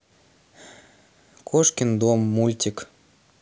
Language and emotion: Russian, neutral